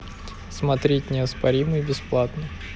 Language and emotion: Russian, neutral